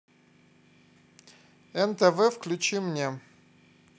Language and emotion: Russian, neutral